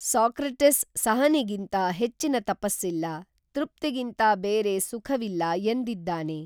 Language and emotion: Kannada, neutral